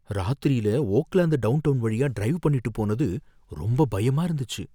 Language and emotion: Tamil, fearful